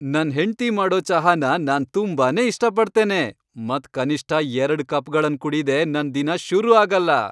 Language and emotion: Kannada, happy